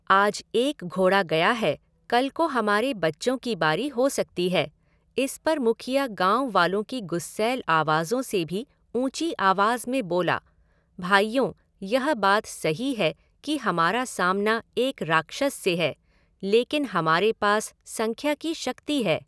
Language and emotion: Hindi, neutral